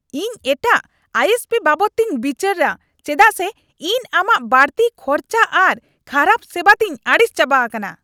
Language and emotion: Santali, angry